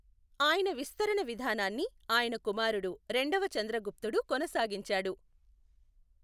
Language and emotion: Telugu, neutral